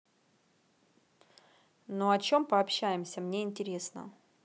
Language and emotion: Russian, neutral